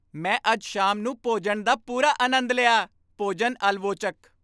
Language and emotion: Punjabi, happy